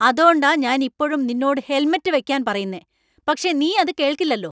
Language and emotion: Malayalam, angry